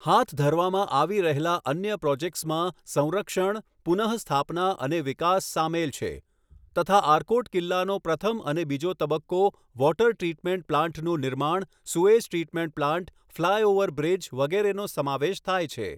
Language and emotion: Gujarati, neutral